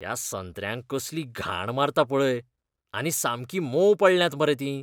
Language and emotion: Goan Konkani, disgusted